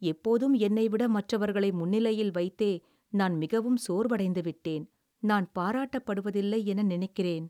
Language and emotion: Tamil, sad